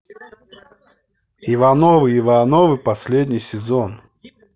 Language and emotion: Russian, neutral